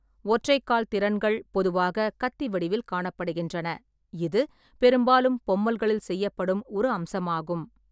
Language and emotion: Tamil, neutral